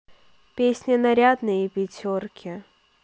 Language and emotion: Russian, neutral